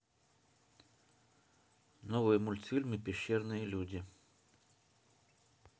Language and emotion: Russian, neutral